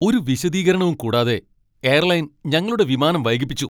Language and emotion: Malayalam, angry